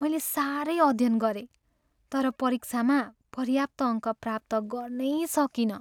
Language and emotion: Nepali, sad